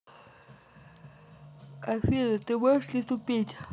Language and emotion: Russian, neutral